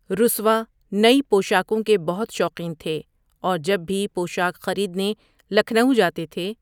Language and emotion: Urdu, neutral